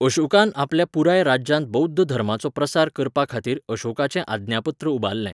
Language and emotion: Goan Konkani, neutral